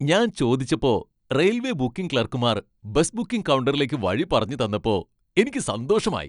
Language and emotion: Malayalam, happy